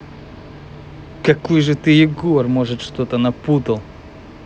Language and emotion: Russian, angry